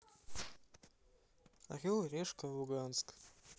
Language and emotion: Russian, neutral